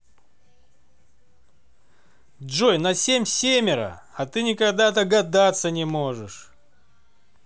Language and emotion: Russian, positive